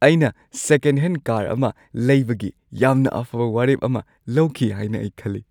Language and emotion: Manipuri, happy